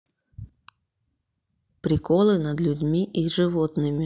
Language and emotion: Russian, neutral